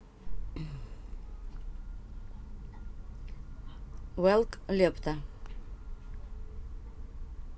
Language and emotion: Russian, neutral